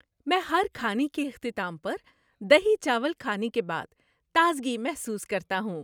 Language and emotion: Urdu, happy